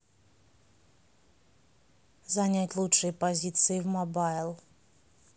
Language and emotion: Russian, neutral